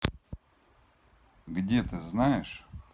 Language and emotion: Russian, neutral